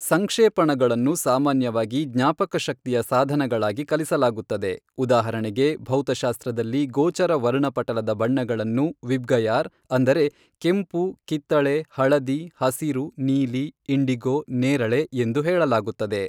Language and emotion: Kannada, neutral